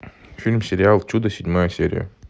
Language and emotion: Russian, neutral